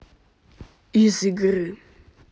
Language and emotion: Russian, angry